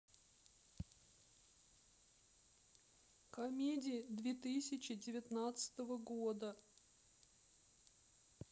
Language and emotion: Russian, sad